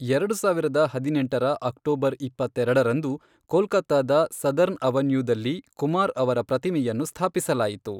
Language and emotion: Kannada, neutral